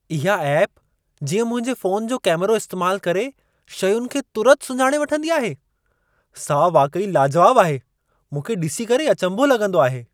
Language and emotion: Sindhi, surprised